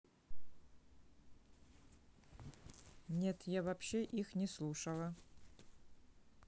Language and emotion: Russian, neutral